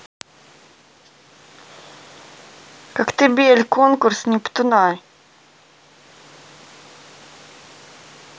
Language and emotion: Russian, neutral